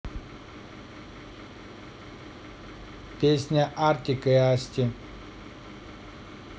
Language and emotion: Russian, neutral